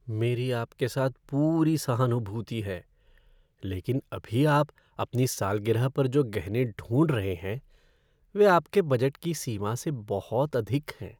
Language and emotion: Hindi, sad